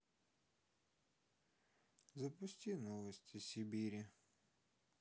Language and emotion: Russian, sad